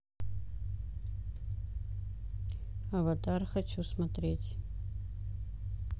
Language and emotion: Russian, neutral